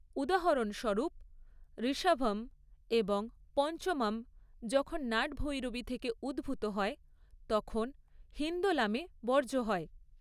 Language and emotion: Bengali, neutral